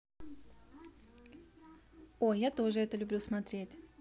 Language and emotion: Russian, positive